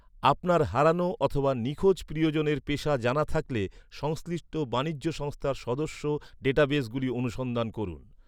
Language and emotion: Bengali, neutral